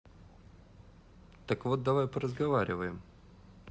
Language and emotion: Russian, neutral